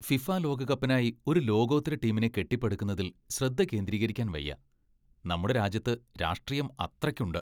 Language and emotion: Malayalam, disgusted